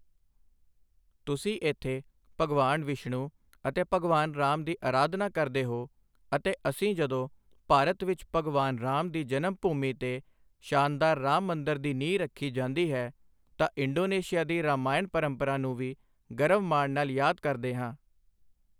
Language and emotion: Punjabi, neutral